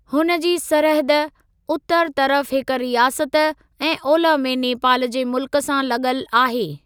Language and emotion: Sindhi, neutral